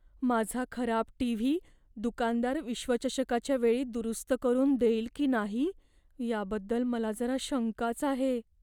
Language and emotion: Marathi, fearful